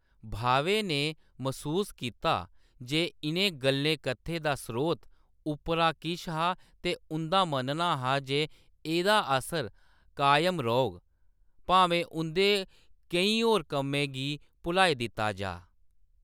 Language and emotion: Dogri, neutral